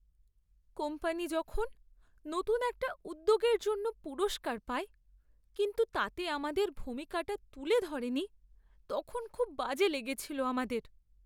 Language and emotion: Bengali, sad